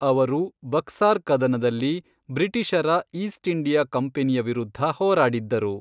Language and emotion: Kannada, neutral